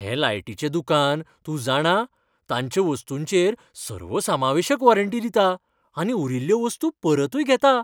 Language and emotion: Goan Konkani, happy